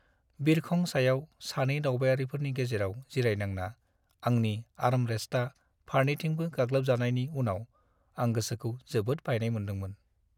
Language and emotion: Bodo, sad